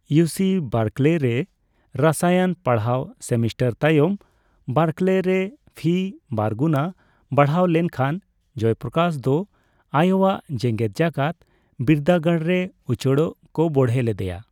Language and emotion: Santali, neutral